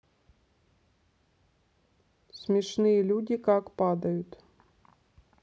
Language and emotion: Russian, neutral